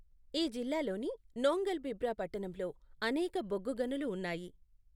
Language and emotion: Telugu, neutral